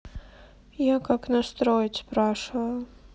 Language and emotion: Russian, sad